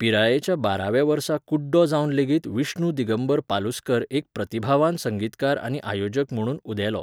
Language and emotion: Goan Konkani, neutral